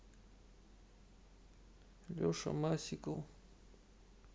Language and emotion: Russian, sad